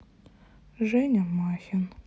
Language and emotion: Russian, sad